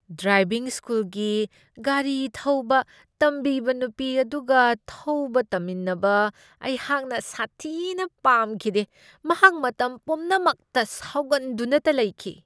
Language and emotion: Manipuri, disgusted